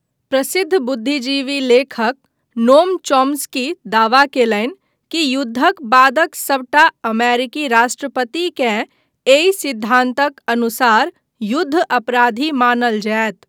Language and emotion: Maithili, neutral